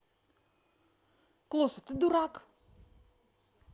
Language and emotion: Russian, angry